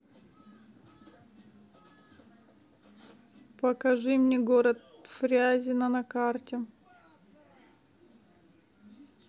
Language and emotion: Russian, sad